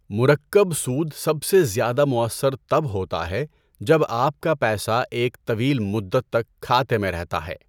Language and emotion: Urdu, neutral